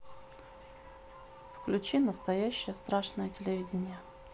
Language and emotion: Russian, neutral